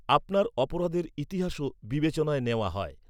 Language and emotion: Bengali, neutral